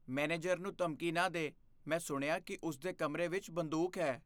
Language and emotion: Punjabi, fearful